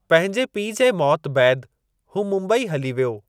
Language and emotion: Sindhi, neutral